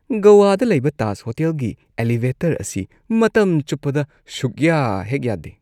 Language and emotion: Manipuri, disgusted